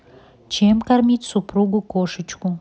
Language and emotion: Russian, neutral